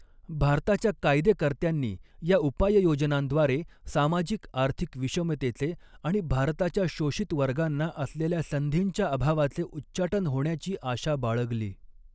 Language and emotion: Marathi, neutral